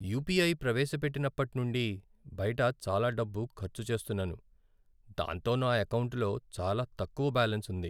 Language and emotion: Telugu, sad